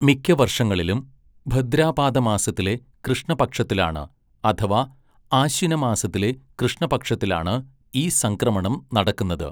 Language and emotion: Malayalam, neutral